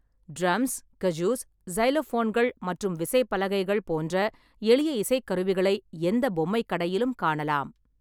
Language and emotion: Tamil, neutral